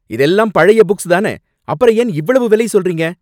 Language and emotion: Tamil, angry